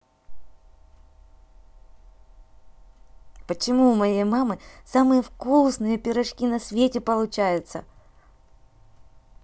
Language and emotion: Russian, positive